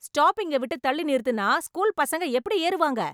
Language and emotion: Tamil, angry